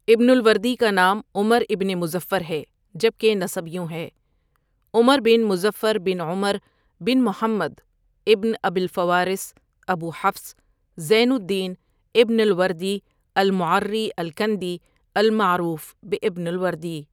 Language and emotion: Urdu, neutral